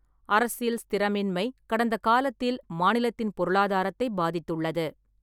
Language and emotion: Tamil, neutral